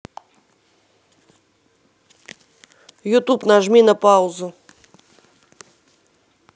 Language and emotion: Russian, neutral